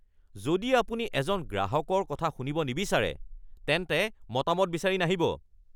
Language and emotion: Assamese, angry